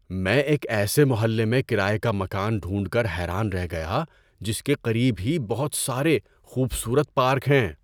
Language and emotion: Urdu, surprised